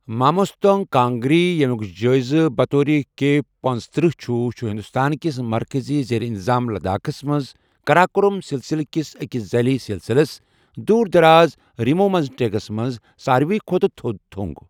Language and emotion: Kashmiri, neutral